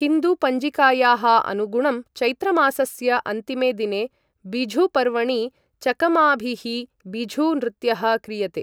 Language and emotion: Sanskrit, neutral